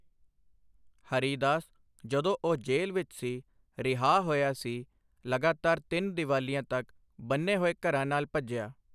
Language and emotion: Punjabi, neutral